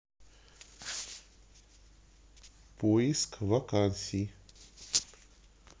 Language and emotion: Russian, neutral